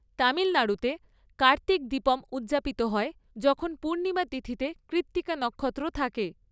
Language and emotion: Bengali, neutral